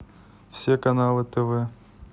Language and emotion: Russian, neutral